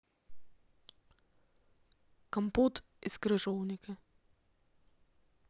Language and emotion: Russian, neutral